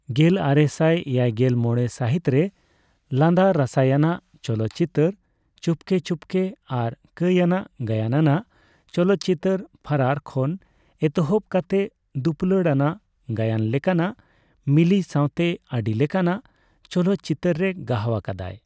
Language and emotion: Santali, neutral